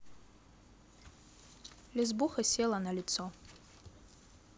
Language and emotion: Russian, neutral